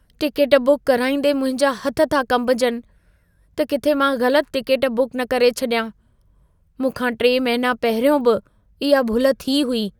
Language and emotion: Sindhi, fearful